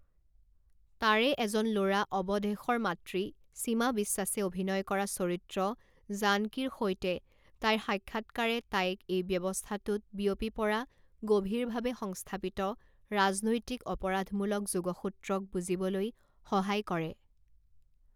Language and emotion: Assamese, neutral